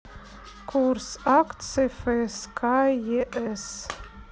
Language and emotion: Russian, neutral